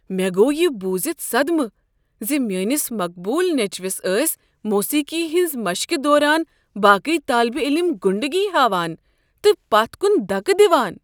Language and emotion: Kashmiri, surprised